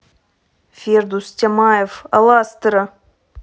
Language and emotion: Russian, neutral